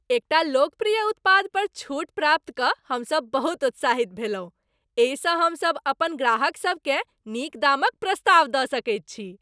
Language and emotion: Maithili, happy